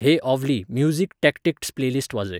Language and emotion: Goan Konkani, neutral